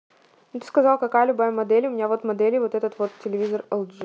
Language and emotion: Russian, neutral